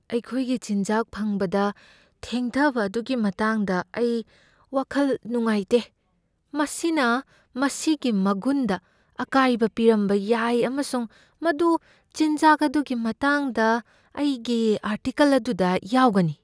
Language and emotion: Manipuri, fearful